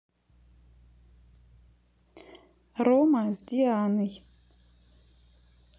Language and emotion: Russian, neutral